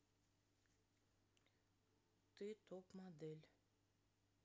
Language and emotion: Russian, neutral